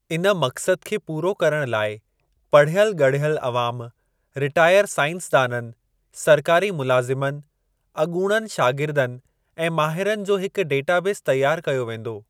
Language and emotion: Sindhi, neutral